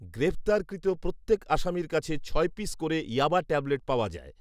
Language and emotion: Bengali, neutral